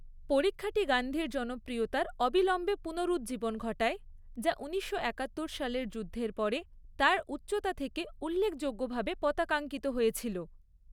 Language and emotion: Bengali, neutral